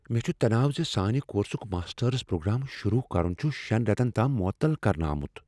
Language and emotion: Kashmiri, fearful